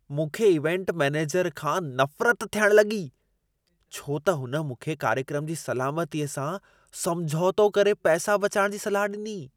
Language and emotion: Sindhi, disgusted